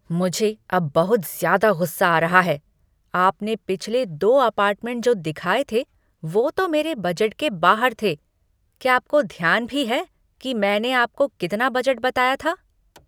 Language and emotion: Hindi, angry